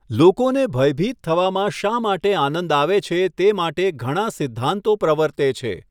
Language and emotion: Gujarati, neutral